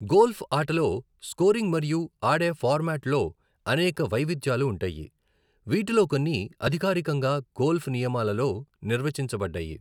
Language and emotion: Telugu, neutral